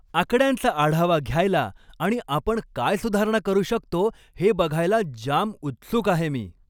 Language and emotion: Marathi, happy